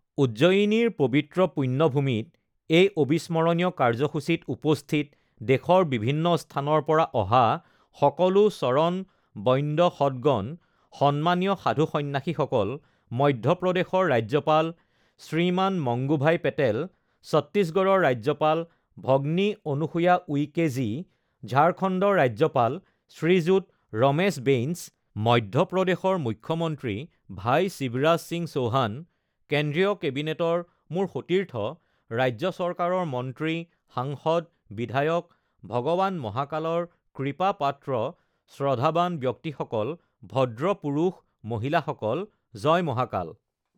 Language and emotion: Assamese, neutral